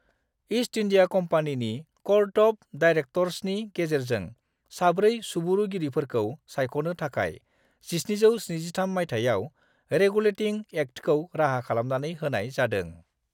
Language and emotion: Bodo, neutral